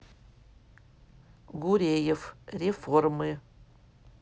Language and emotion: Russian, neutral